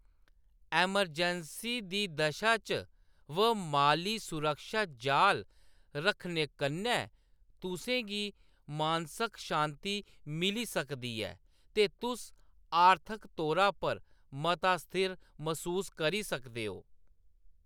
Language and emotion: Dogri, neutral